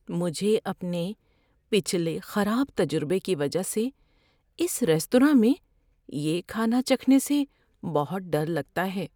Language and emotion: Urdu, fearful